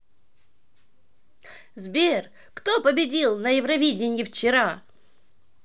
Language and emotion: Russian, positive